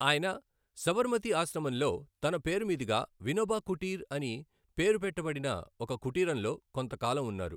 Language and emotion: Telugu, neutral